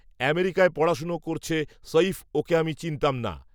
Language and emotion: Bengali, neutral